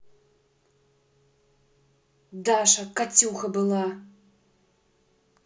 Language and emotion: Russian, angry